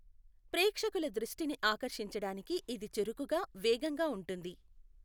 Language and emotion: Telugu, neutral